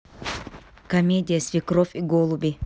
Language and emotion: Russian, neutral